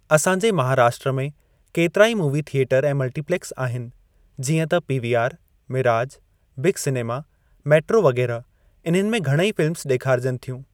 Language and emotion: Sindhi, neutral